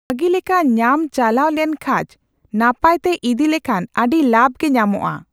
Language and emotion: Santali, neutral